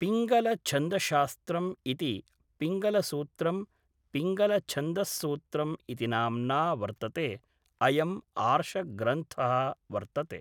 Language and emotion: Sanskrit, neutral